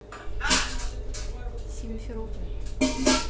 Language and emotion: Russian, neutral